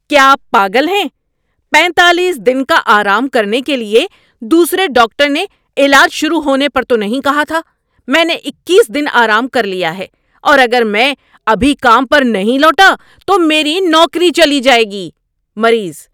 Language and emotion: Urdu, angry